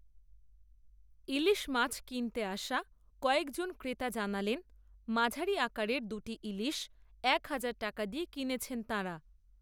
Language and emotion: Bengali, neutral